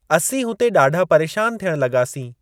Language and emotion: Sindhi, neutral